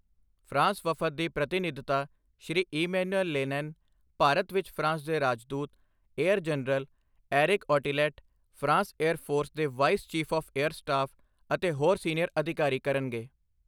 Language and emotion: Punjabi, neutral